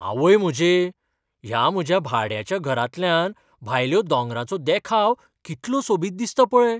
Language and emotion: Goan Konkani, surprised